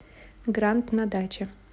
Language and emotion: Russian, neutral